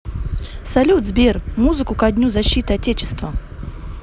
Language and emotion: Russian, positive